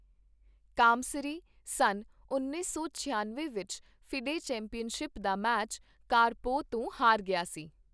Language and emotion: Punjabi, neutral